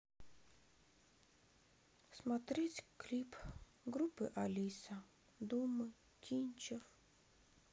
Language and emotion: Russian, sad